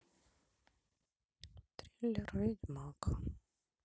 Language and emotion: Russian, sad